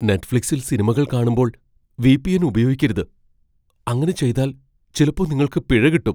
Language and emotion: Malayalam, fearful